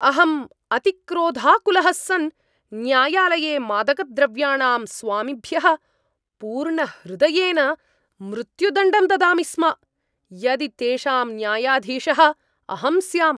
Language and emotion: Sanskrit, angry